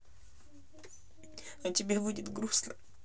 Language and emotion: Russian, sad